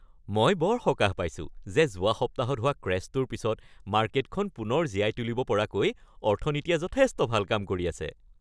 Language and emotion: Assamese, happy